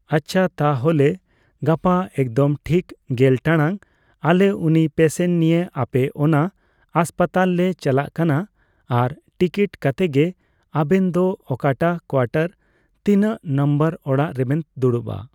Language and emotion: Santali, neutral